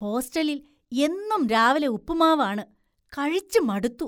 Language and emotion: Malayalam, disgusted